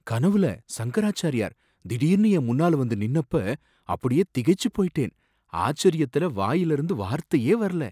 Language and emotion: Tamil, surprised